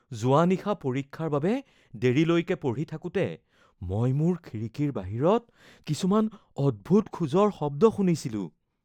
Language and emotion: Assamese, fearful